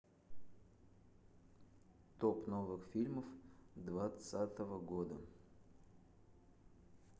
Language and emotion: Russian, neutral